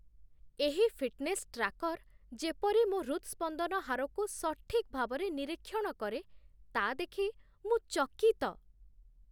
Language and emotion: Odia, surprised